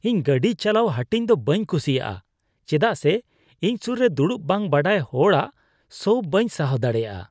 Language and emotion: Santali, disgusted